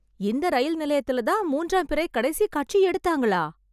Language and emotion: Tamil, surprised